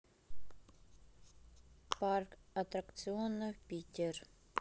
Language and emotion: Russian, neutral